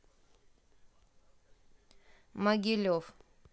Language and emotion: Russian, neutral